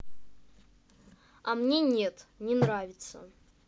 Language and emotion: Russian, angry